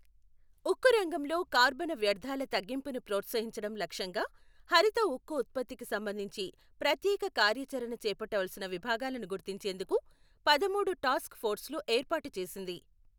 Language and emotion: Telugu, neutral